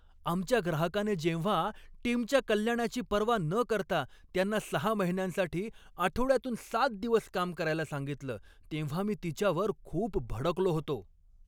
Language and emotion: Marathi, angry